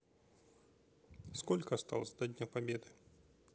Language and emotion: Russian, neutral